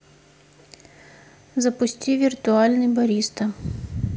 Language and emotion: Russian, neutral